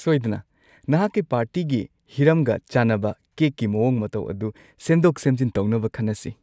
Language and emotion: Manipuri, happy